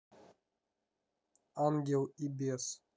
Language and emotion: Russian, neutral